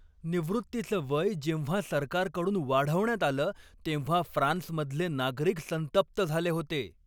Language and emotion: Marathi, angry